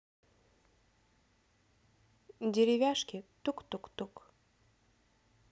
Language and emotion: Russian, neutral